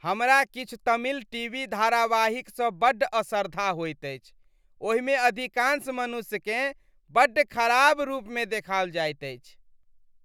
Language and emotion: Maithili, disgusted